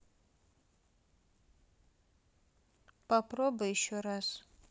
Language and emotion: Russian, neutral